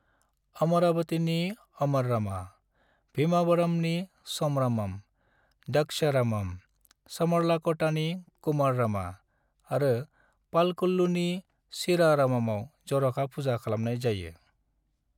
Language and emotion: Bodo, neutral